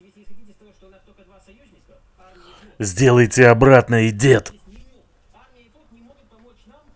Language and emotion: Russian, angry